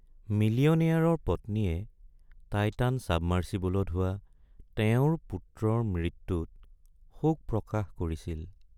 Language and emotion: Assamese, sad